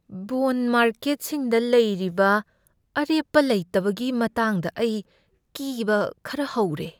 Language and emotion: Manipuri, fearful